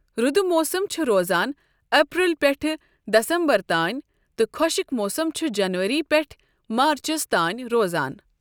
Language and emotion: Kashmiri, neutral